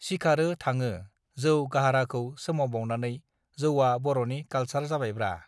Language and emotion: Bodo, neutral